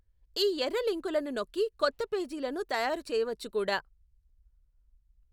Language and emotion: Telugu, neutral